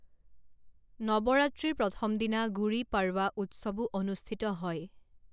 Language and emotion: Assamese, neutral